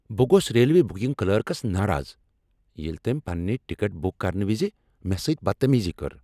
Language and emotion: Kashmiri, angry